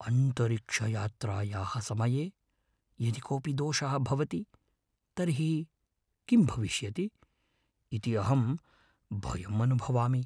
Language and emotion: Sanskrit, fearful